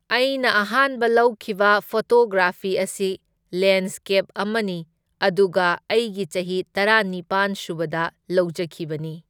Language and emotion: Manipuri, neutral